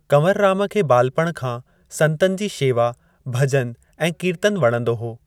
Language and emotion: Sindhi, neutral